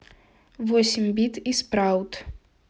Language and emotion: Russian, neutral